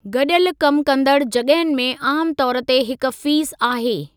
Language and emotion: Sindhi, neutral